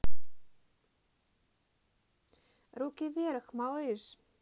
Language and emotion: Russian, positive